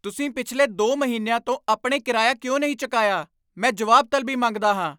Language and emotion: Punjabi, angry